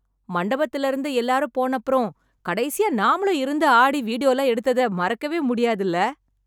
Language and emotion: Tamil, happy